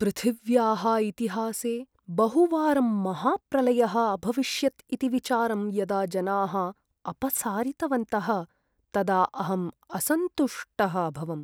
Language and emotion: Sanskrit, sad